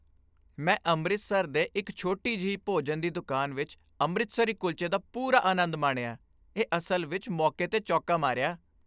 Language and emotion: Punjabi, happy